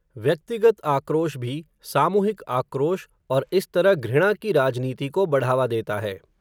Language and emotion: Hindi, neutral